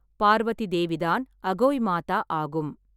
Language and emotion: Tamil, neutral